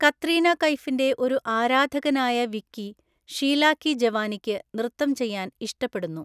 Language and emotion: Malayalam, neutral